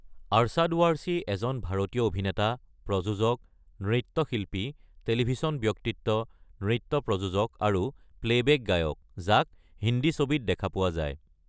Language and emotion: Assamese, neutral